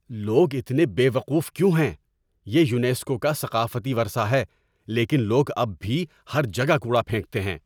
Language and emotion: Urdu, angry